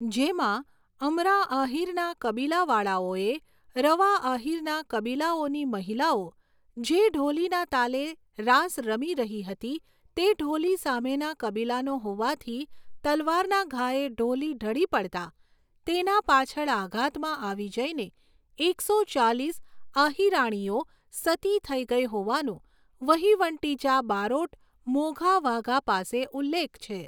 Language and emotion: Gujarati, neutral